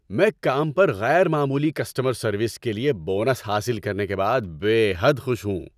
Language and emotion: Urdu, happy